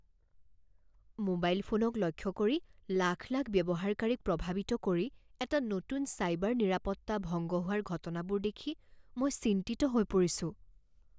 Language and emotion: Assamese, fearful